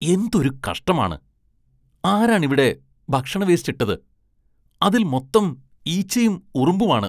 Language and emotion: Malayalam, disgusted